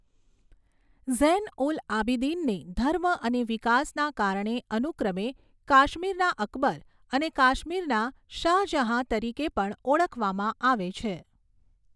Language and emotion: Gujarati, neutral